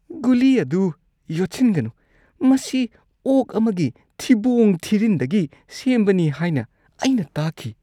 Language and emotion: Manipuri, disgusted